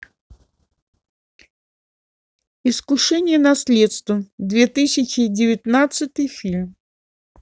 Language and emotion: Russian, neutral